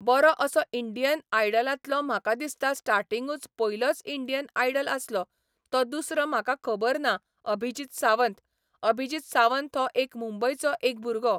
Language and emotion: Goan Konkani, neutral